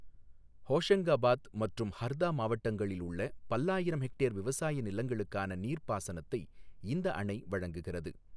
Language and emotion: Tamil, neutral